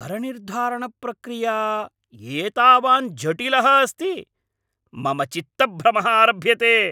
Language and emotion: Sanskrit, angry